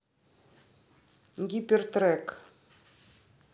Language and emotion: Russian, neutral